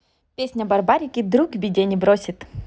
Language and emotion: Russian, positive